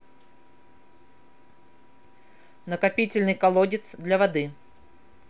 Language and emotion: Russian, neutral